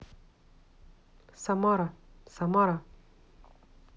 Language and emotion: Russian, neutral